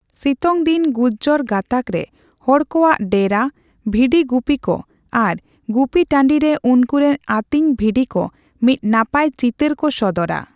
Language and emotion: Santali, neutral